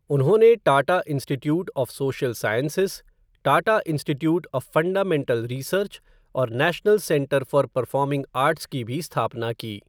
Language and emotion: Hindi, neutral